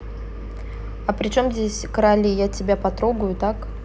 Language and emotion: Russian, neutral